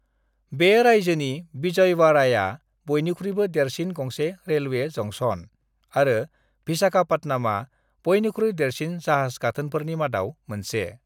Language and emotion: Bodo, neutral